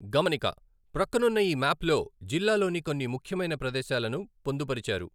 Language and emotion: Telugu, neutral